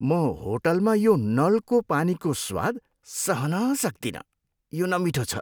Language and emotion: Nepali, disgusted